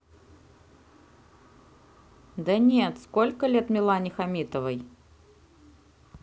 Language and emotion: Russian, neutral